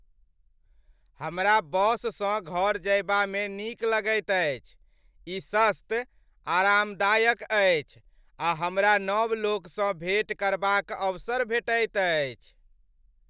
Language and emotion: Maithili, happy